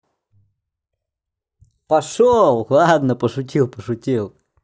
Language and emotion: Russian, positive